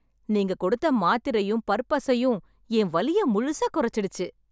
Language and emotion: Tamil, happy